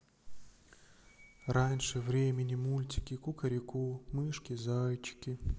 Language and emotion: Russian, sad